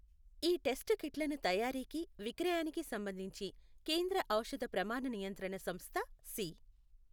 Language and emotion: Telugu, neutral